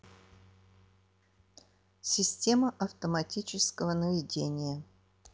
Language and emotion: Russian, neutral